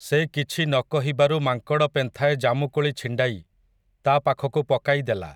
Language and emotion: Odia, neutral